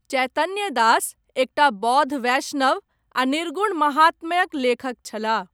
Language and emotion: Maithili, neutral